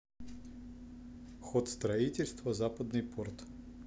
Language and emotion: Russian, neutral